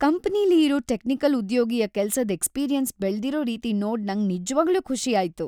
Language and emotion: Kannada, happy